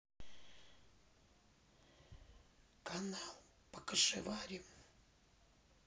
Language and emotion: Russian, neutral